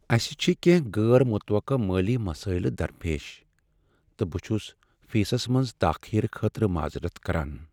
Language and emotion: Kashmiri, sad